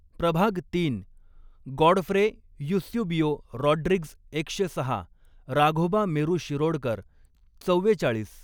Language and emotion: Marathi, neutral